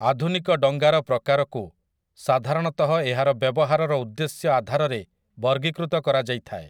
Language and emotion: Odia, neutral